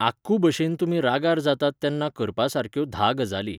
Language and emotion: Goan Konkani, neutral